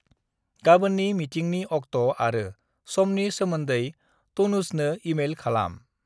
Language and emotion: Bodo, neutral